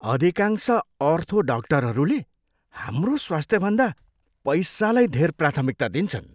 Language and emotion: Nepali, disgusted